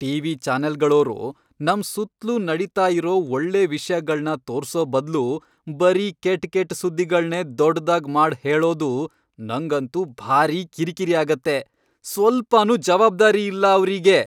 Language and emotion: Kannada, angry